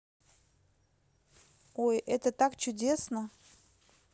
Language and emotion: Russian, positive